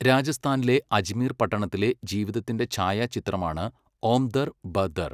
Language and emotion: Malayalam, neutral